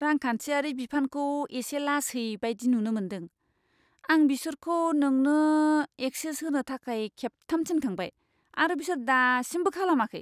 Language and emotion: Bodo, disgusted